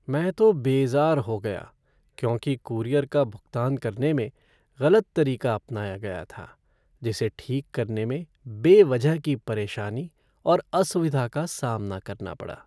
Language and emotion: Hindi, sad